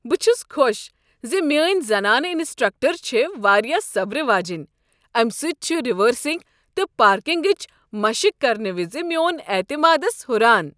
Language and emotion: Kashmiri, happy